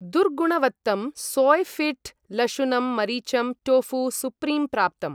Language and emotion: Sanskrit, neutral